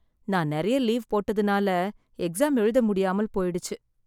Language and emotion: Tamil, sad